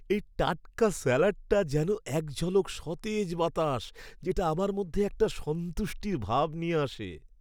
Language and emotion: Bengali, happy